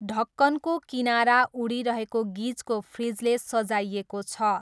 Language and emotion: Nepali, neutral